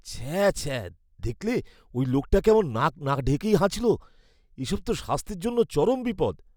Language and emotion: Bengali, disgusted